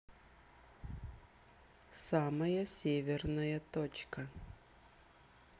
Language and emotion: Russian, neutral